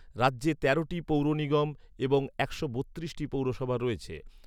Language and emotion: Bengali, neutral